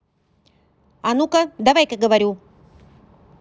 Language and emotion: Russian, angry